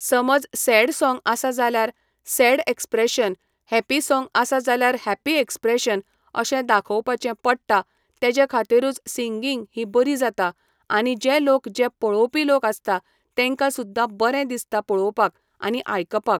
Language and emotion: Goan Konkani, neutral